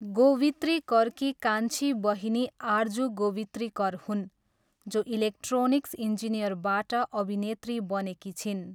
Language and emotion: Nepali, neutral